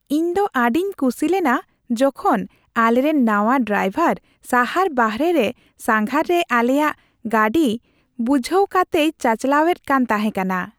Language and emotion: Santali, happy